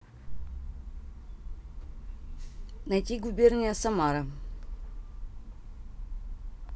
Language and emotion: Russian, neutral